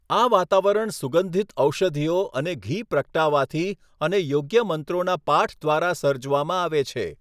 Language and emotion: Gujarati, neutral